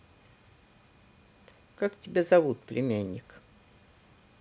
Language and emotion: Russian, neutral